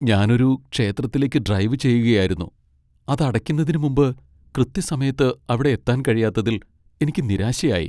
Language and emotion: Malayalam, sad